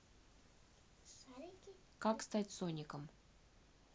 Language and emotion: Russian, neutral